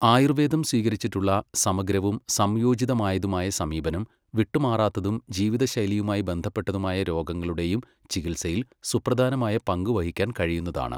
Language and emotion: Malayalam, neutral